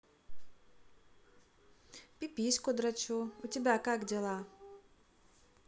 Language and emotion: Russian, neutral